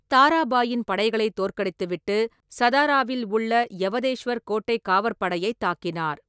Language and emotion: Tamil, neutral